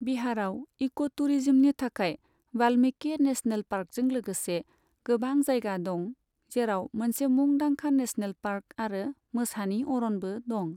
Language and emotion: Bodo, neutral